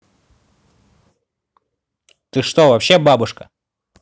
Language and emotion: Russian, angry